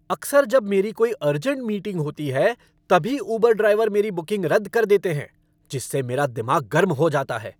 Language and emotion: Hindi, angry